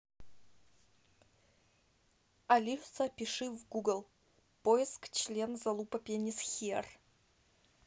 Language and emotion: Russian, neutral